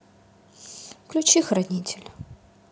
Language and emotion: Russian, sad